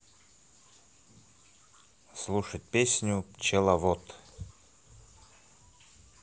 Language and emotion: Russian, positive